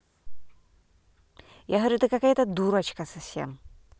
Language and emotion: Russian, angry